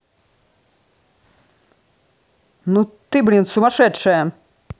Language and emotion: Russian, angry